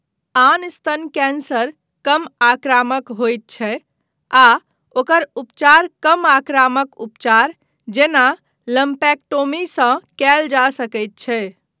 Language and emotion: Maithili, neutral